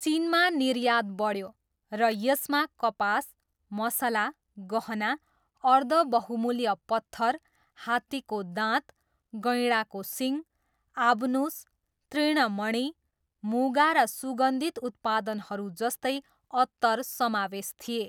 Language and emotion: Nepali, neutral